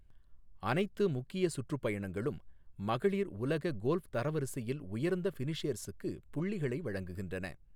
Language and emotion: Tamil, neutral